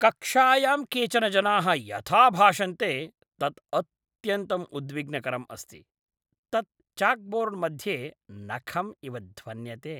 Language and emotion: Sanskrit, disgusted